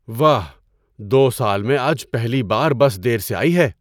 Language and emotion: Urdu, surprised